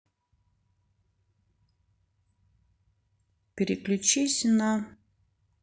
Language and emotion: Russian, neutral